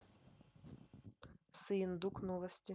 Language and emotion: Russian, neutral